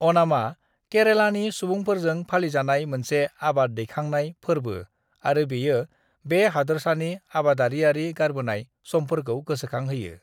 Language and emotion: Bodo, neutral